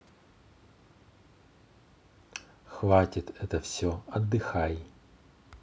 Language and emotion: Russian, neutral